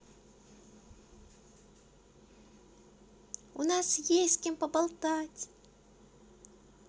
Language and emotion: Russian, positive